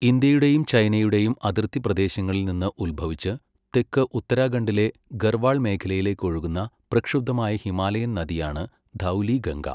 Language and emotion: Malayalam, neutral